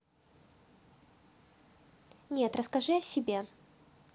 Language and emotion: Russian, neutral